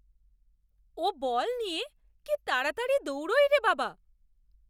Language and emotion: Bengali, surprised